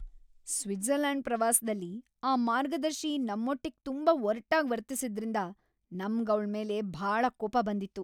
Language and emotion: Kannada, angry